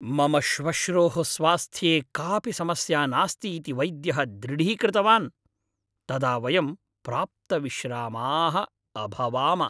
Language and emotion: Sanskrit, happy